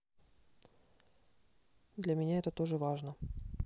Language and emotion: Russian, neutral